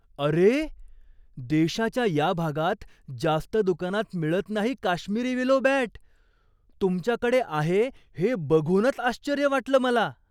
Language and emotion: Marathi, surprised